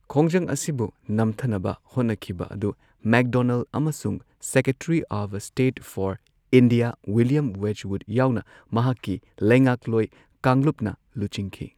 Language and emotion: Manipuri, neutral